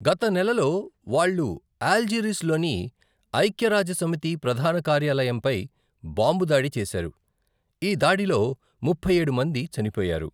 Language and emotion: Telugu, neutral